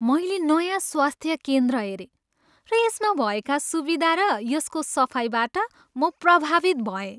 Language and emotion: Nepali, happy